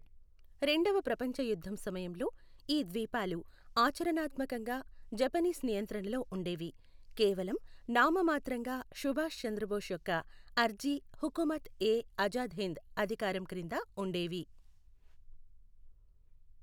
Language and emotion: Telugu, neutral